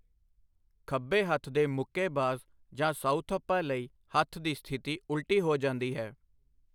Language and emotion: Punjabi, neutral